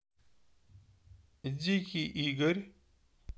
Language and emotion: Russian, neutral